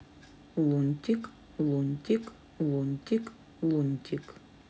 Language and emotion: Russian, neutral